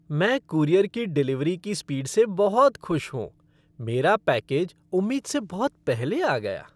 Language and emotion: Hindi, happy